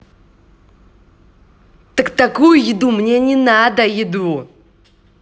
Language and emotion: Russian, angry